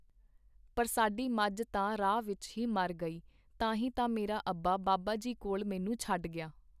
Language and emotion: Punjabi, neutral